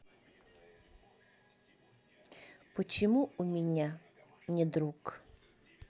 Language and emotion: Russian, neutral